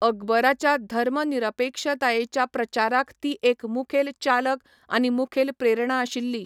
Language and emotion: Goan Konkani, neutral